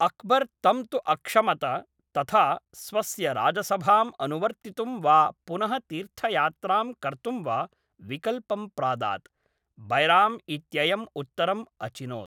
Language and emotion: Sanskrit, neutral